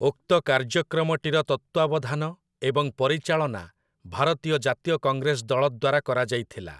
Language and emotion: Odia, neutral